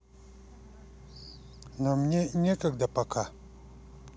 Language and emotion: Russian, neutral